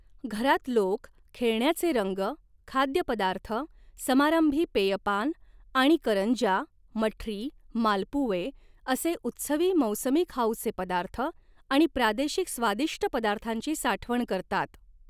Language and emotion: Marathi, neutral